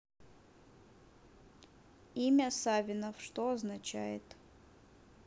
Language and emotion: Russian, neutral